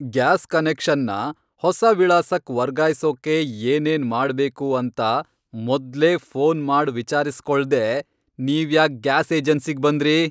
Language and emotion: Kannada, angry